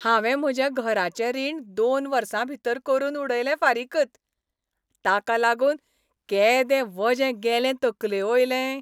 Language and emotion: Goan Konkani, happy